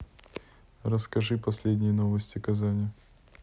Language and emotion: Russian, neutral